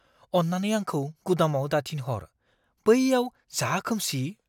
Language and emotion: Bodo, fearful